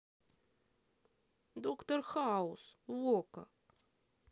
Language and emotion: Russian, sad